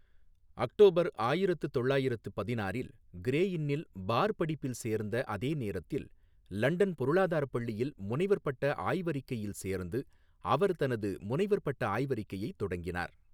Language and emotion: Tamil, neutral